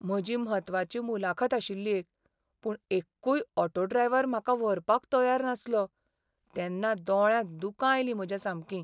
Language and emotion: Goan Konkani, sad